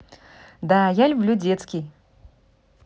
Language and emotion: Russian, positive